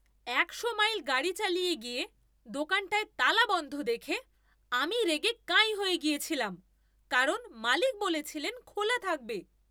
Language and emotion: Bengali, angry